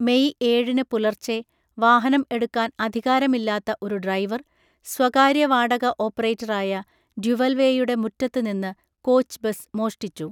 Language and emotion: Malayalam, neutral